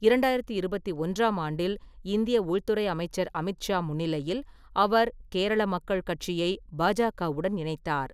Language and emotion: Tamil, neutral